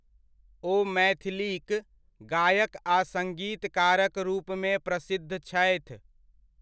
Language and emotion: Maithili, neutral